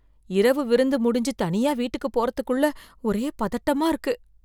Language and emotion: Tamil, fearful